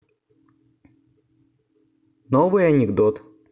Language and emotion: Russian, positive